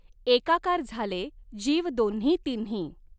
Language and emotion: Marathi, neutral